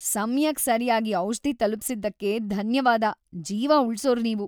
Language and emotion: Kannada, happy